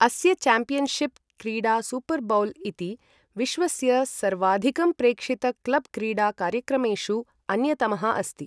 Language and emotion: Sanskrit, neutral